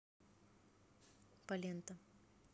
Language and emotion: Russian, neutral